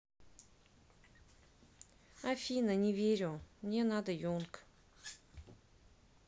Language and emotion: Russian, sad